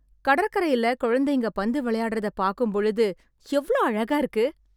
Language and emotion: Tamil, happy